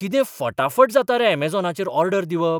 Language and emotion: Goan Konkani, surprised